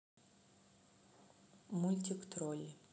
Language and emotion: Russian, neutral